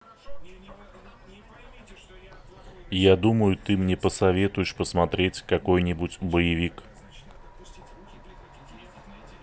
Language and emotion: Russian, neutral